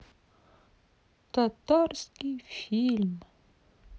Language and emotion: Russian, sad